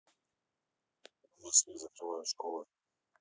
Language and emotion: Russian, neutral